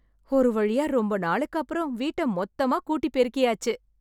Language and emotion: Tamil, happy